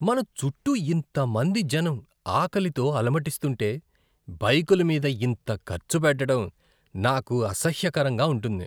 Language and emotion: Telugu, disgusted